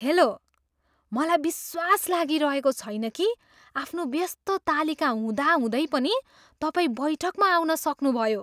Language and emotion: Nepali, surprised